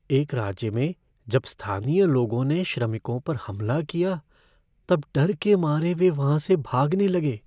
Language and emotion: Hindi, fearful